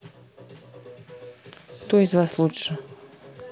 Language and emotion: Russian, neutral